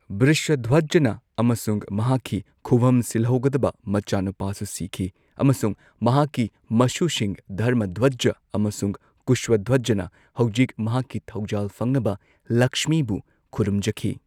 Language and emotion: Manipuri, neutral